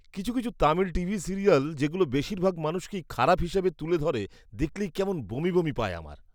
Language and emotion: Bengali, disgusted